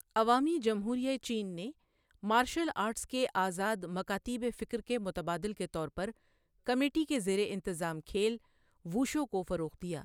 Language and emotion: Urdu, neutral